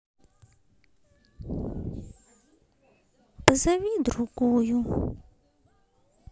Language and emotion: Russian, sad